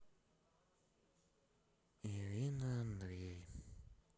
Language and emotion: Russian, sad